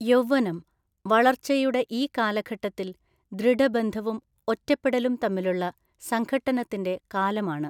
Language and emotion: Malayalam, neutral